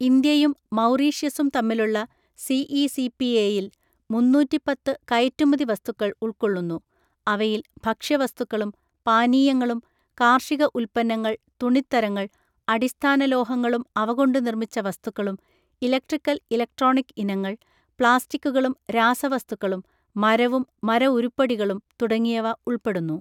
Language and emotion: Malayalam, neutral